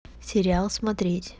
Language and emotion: Russian, neutral